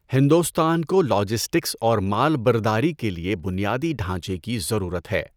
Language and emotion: Urdu, neutral